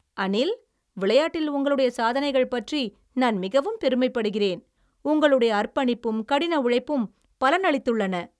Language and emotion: Tamil, happy